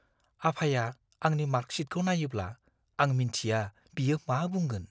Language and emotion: Bodo, fearful